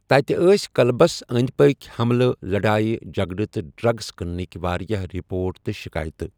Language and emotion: Kashmiri, neutral